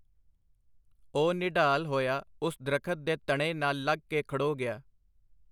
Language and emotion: Punjabi, neutral